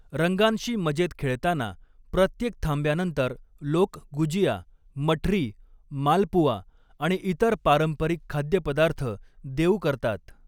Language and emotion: Marathi, neutral